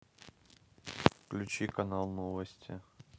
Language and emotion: Russian, neutral